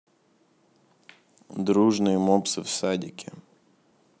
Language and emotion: Russian, neutral